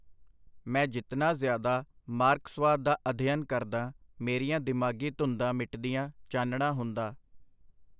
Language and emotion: Punjabi, neutral